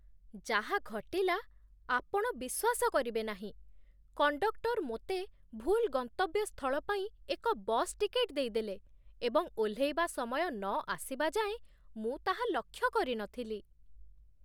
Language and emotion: Odia, surprised